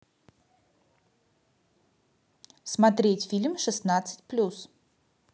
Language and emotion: Russian, positive